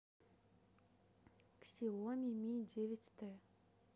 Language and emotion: Russian, neutral